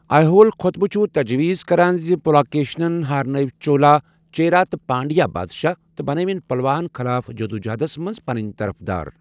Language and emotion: Kashmiri, neutral